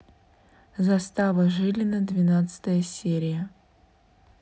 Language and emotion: Russian, neutral